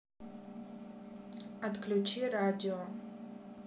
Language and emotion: Russian, neutral